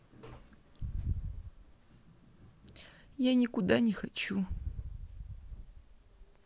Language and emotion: Russian, sad